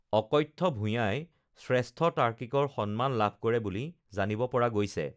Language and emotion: Assamese, neutral